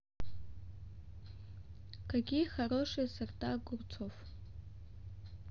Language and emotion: Russian, neutral